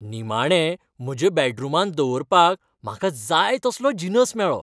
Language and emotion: Goan Konkani, happy